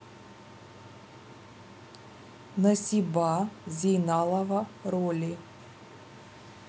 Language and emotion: Russian, neutral